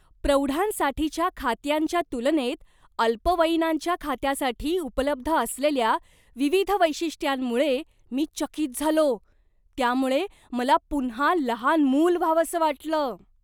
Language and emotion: Marathi, surprised